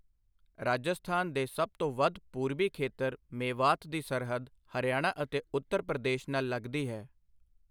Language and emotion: Punjabi, neutral